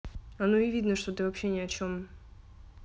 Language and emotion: Russian, neutral